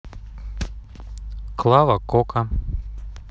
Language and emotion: Russian, neutral